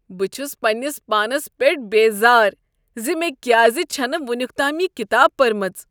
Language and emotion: Kashmiri, disgusted